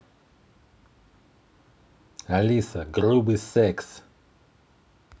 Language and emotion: Russian, angry